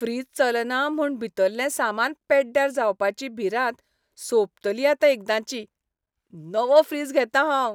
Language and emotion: Goan Konkani, happy